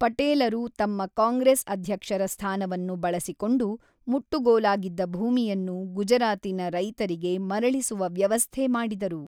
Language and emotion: Kannada, neutral